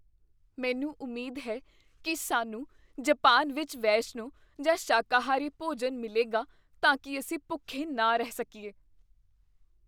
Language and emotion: Punjabi, fearful